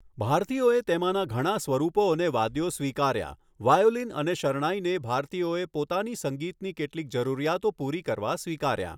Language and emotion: Gujarati, neutral